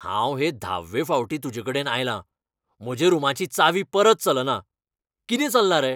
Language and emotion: Goan Konkani, angry